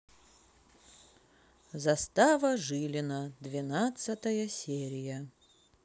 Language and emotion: Russian, neutral